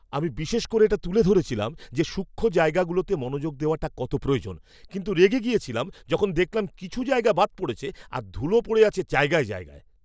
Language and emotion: Bengali, angry